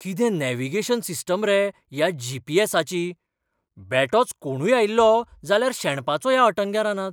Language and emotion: Goan Konkani, surprised